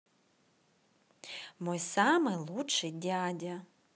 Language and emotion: Russian, positive